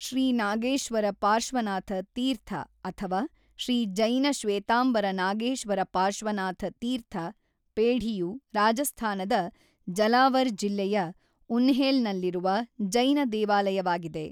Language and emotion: Kannada, neutral